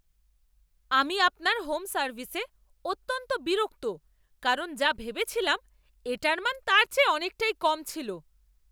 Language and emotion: Bengali, angry